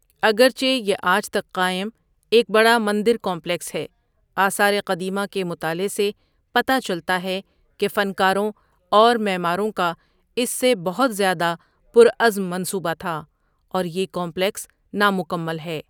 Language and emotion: Urdu, neutral